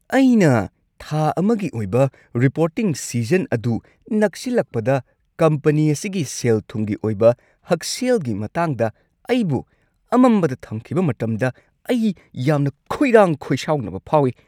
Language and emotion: Manipuri, angry